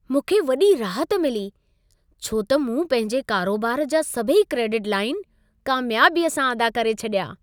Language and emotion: Sindhi, happy